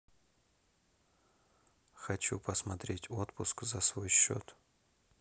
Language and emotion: Russian, neutral